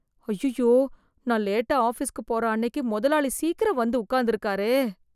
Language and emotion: Tamil, fearful